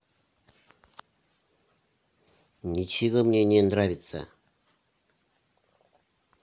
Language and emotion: Russian, angry